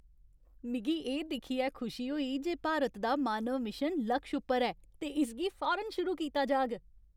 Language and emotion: Dogri, happy